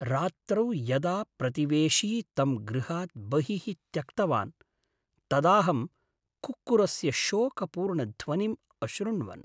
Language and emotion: Sanskrit, sad